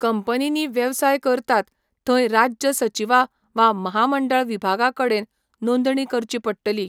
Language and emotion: Goan Konkani, neutral